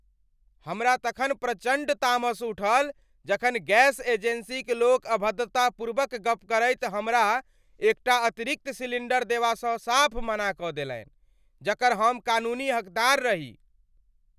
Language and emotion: Maithili, angry